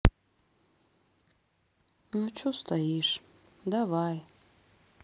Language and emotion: Russian, sad